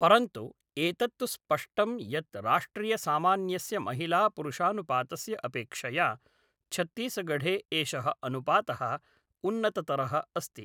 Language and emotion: Sanskrit, neutral